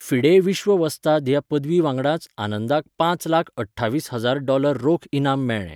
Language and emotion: Goan Konkani, neutral